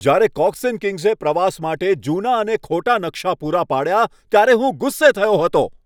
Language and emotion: Gujarati, angry